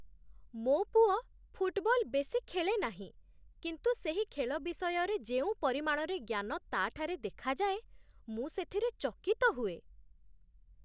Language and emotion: Odia, surprised